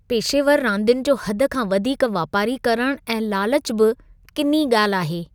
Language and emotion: Sindhi, disgusted